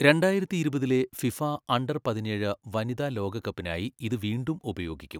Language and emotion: Malayalam, neutral